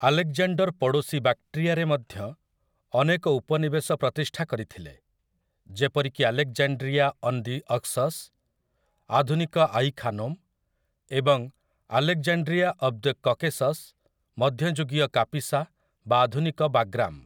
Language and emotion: Odia, neutral